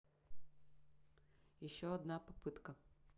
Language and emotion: Russian, neutral